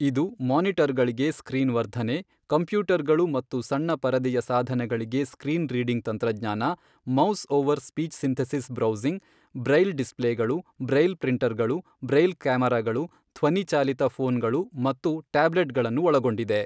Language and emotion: Kannada, neutral